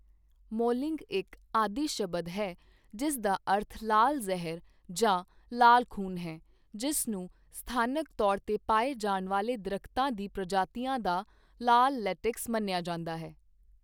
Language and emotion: Punjabi, neutral